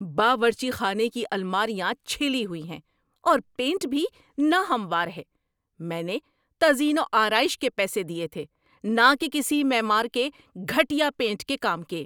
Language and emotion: Urdu, angry